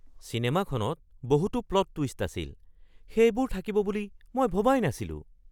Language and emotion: Assamese, surprised